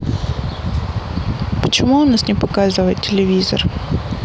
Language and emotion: Russian, sad